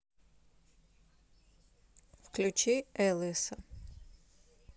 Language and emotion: Russian, neutral